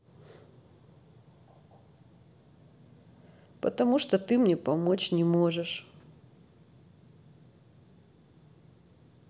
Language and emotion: Russian, sad